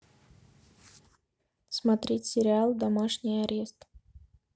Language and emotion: Russian, neutral